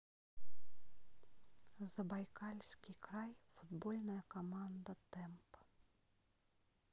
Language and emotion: Russian, neutral